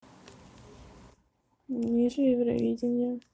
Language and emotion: Russian, neutral